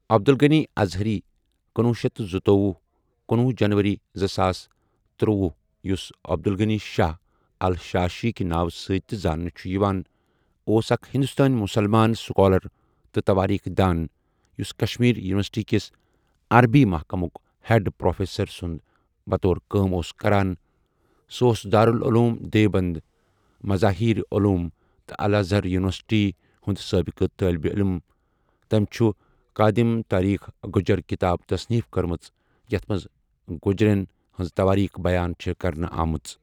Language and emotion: Kashmiri, neutral